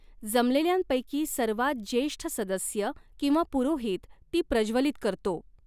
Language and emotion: Marathi, neutral